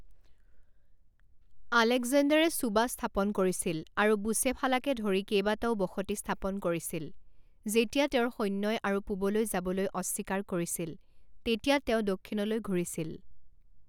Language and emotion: Assamese, neutral